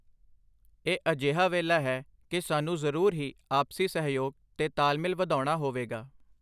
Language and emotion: Punjabi, neutral